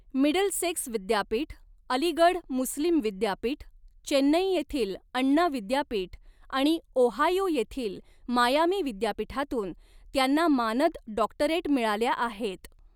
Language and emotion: Marathi, neutral